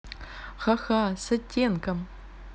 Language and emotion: Russian, neutral